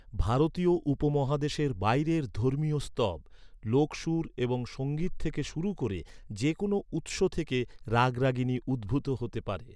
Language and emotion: Bengali, neutral